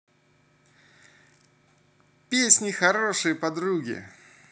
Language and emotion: Russian, positive